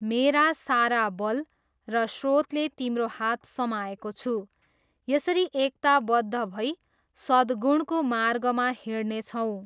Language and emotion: Nepali, neutral